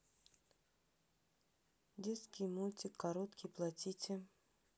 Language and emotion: Russian, neutral